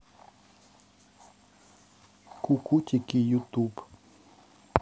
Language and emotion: Russian, neutral